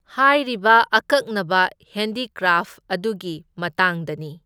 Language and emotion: Manipuri, neutral